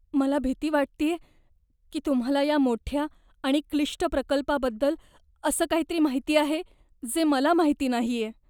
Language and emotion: Marathi, fearful